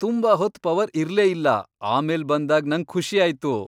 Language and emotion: Kannada, happy